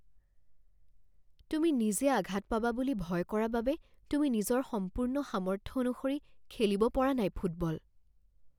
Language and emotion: Assamese, fearful